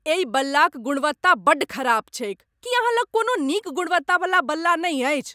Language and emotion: Maithili, angry